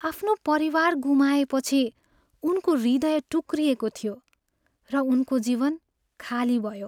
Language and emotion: Nepali, sad